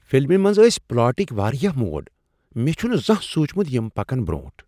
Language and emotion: Kashmiri, surprised